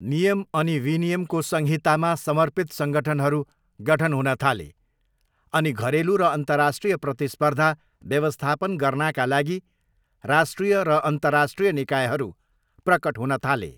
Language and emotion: Nepali, neutral